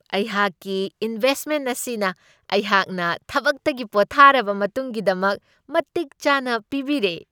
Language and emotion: Manipuri, happy